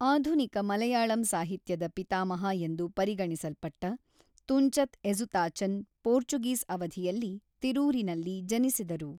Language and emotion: Kannada, neutral